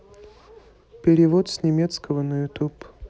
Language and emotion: Russian, neutral